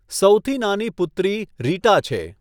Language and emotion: Gujarati, neutral